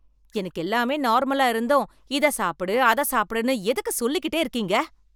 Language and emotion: Tamil, angry